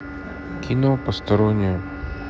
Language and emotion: Russian, neutral